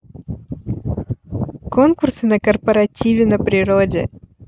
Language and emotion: Russian, positive